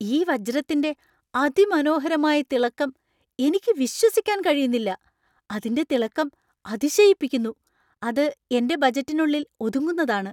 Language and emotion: Malayalam, surprised